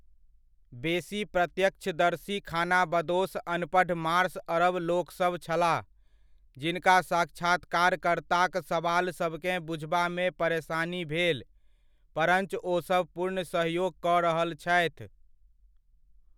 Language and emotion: Maithili, neutral